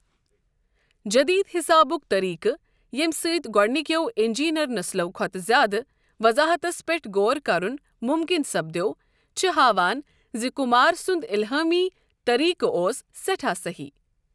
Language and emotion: Kashmiri, neutral